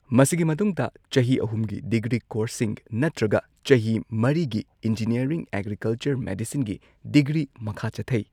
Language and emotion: Manipuri, neutral